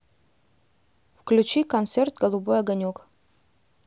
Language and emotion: Russian, neutral